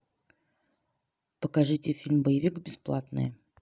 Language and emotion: Russian, neutral